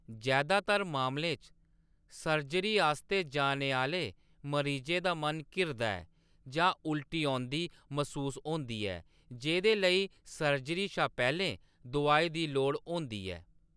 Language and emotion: Dogri, neutral